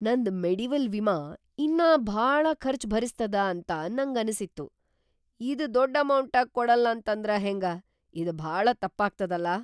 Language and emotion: Kannada, surprised